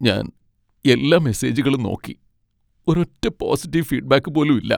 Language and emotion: Malayalam, sad